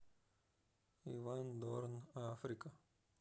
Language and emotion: Russian, neutral